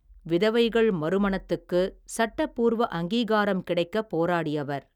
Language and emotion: Tamil, neutral